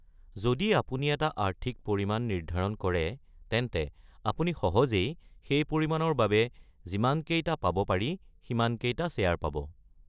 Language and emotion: Assamese, neutral